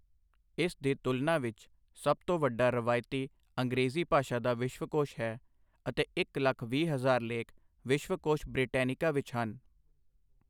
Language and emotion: Punjabi, neutral